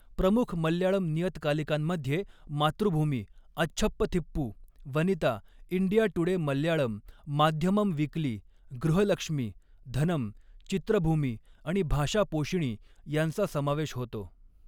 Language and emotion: Marathi, neutral